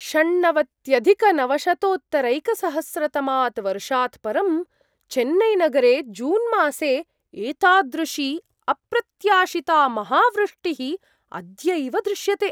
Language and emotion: Sanskrit, surprised